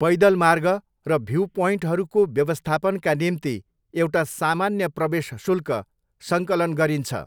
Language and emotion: Nepali, neutral